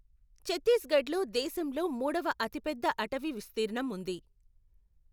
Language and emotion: Telugu, neutral